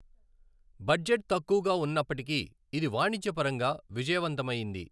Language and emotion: Telugu, neutral